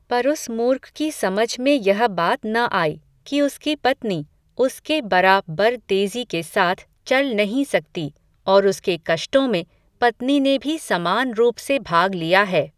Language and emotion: Hindi, neutral